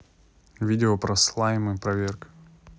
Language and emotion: Russian, neutral